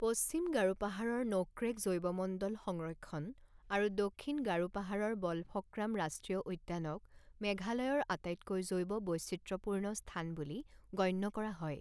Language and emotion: Assamese, neutral